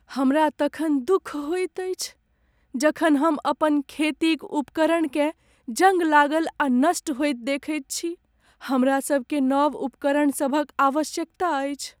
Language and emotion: Maithili, sad